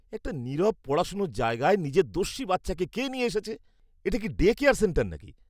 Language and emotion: Bengali, disgusted